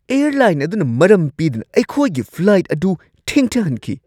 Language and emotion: Manipuri, angry